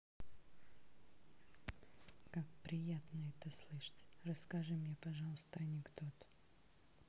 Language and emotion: Russian, neutral